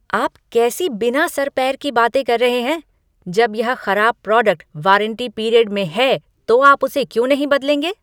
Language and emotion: Hindi, angry